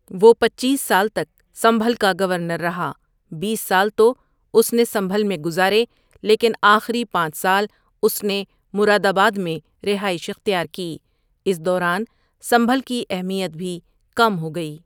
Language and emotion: Urdu, neutral